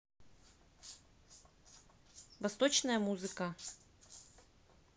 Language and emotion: Russian, neutral